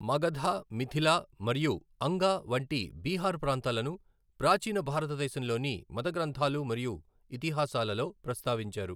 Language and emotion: Telugu, neutral